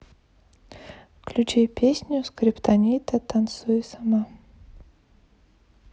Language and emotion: Russian, sad